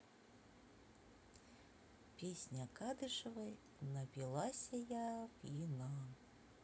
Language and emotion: Russian, neutral